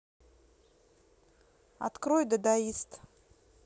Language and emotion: Russian, neutral